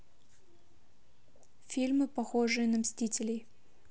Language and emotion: Russian, neutral